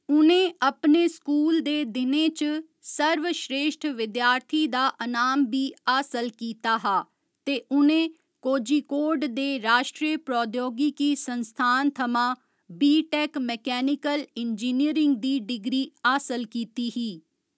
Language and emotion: Dogri, neutral